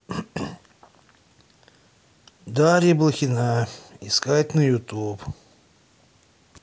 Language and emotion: Russian, sad